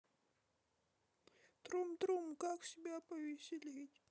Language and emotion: Russian, sad